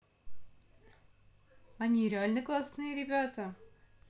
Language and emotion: Russian, positive